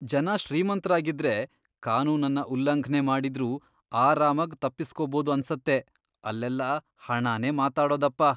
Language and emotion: Kannada, disgusted